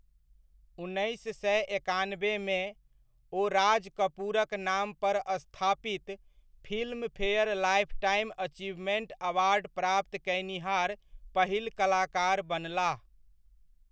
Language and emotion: Maithili, neutral